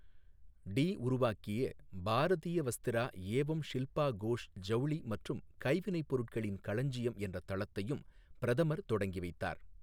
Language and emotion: Tamil, neutral